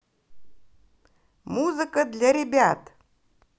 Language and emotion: Russian, positive